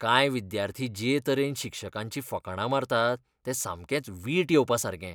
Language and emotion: Goan Konkani, disgusted